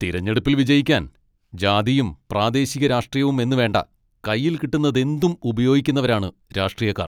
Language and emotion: Malayalam, angry